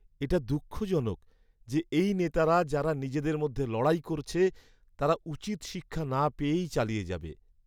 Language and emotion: Bengali, sad